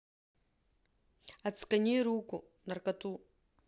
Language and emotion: Russian, neutral